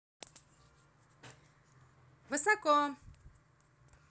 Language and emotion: Russian, positive